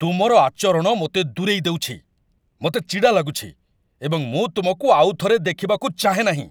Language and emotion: Odia, angry